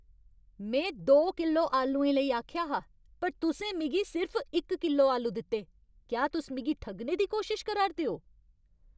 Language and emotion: Dogri, angry